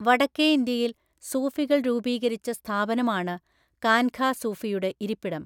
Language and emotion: Malayalam, neutral